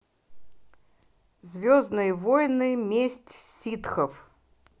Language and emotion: Russian, positive